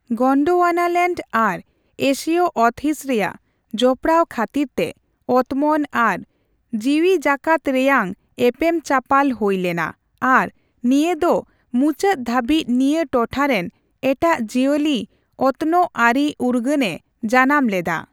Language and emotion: Santali, neutral